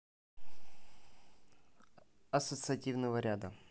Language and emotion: Russian, neutral